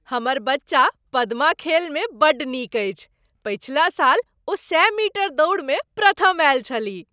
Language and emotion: Maithili, happy